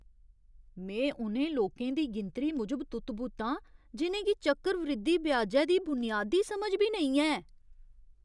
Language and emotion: Dogri, surprised